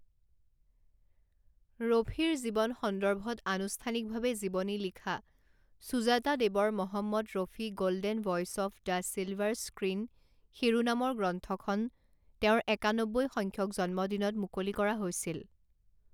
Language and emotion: Assamese, neutral